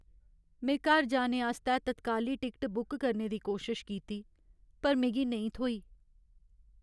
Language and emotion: Dogri, sad